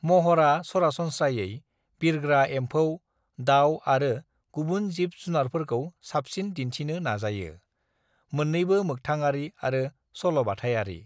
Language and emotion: Bodo, neutral